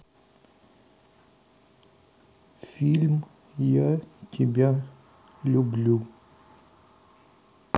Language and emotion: Russian, sad